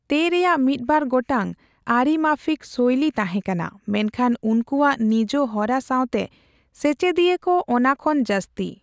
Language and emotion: Santali, neutral